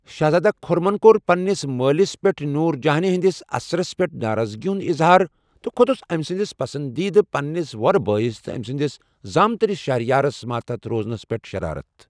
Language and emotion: Kashmiri, neutral